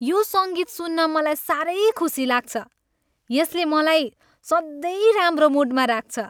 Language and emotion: Nepali, happy